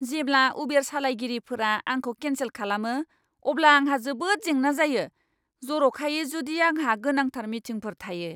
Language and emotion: Bodo, angry